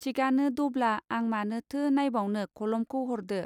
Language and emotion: Bodo, neutral